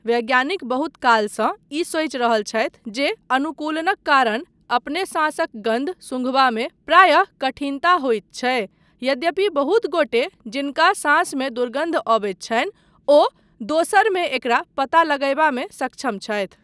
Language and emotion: Maithili, neutral